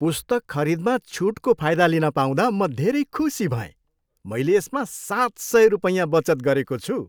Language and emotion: Nepali, happy